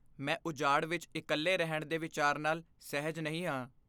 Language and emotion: Punjabi, fearful